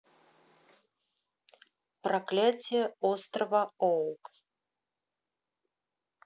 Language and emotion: Russian, neutral